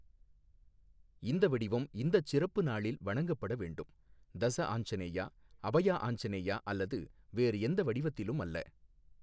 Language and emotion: Tamil, neutral